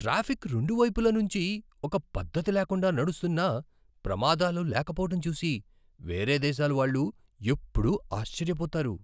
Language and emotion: Telugu, surprised